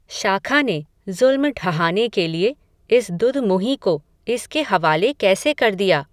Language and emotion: Hindi, neutral